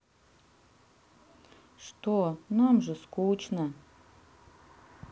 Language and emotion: Russian, sad